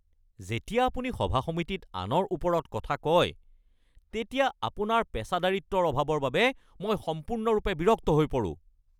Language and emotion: Assamese, angry